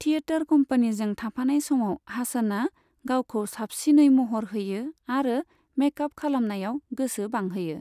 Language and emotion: Bodo, neutral